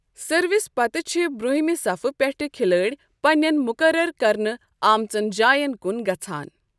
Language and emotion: Kashmiri, neutral